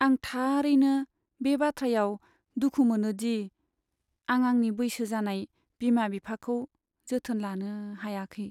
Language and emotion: Bodo, sad